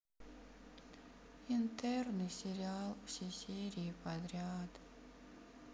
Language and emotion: Russian, sad